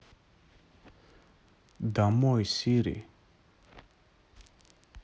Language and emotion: Russian, neutral